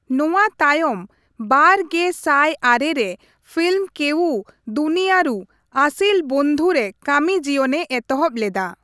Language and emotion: Santali, neutral